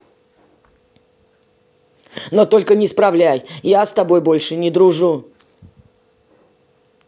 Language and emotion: Russian, angry